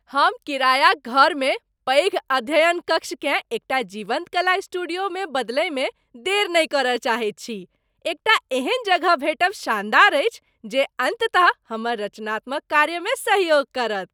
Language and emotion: Maithili, happy